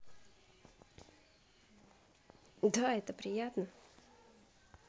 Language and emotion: Russian, positive